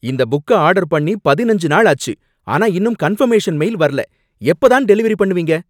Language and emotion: Tamil, angry